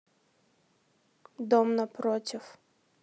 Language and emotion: Russian, neutral